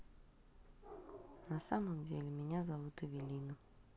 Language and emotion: Russian, neutral